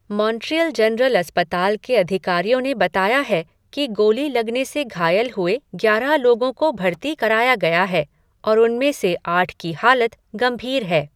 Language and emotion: Hindi, neutral